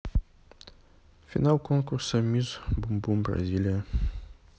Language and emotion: Russian, neutral